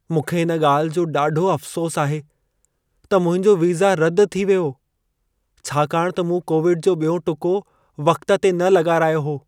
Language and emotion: Sindhi, sad